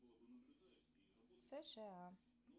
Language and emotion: Russian, neutral